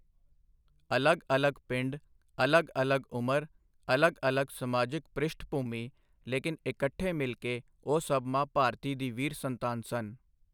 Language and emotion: Punjabi, neutral